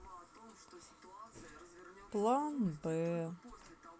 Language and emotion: Russian, sad